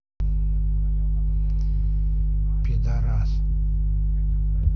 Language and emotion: Russian, neutral